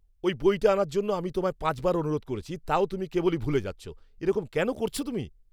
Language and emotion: Bengali, angry